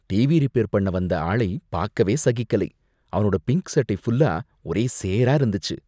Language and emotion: Tamil, disgusted